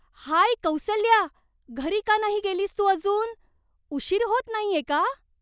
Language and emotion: Marathi, surprised